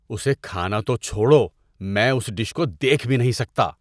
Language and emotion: Urdu, disgusted